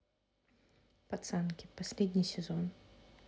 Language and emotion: Russian, neutral